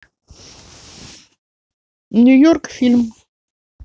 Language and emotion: Russian, neutral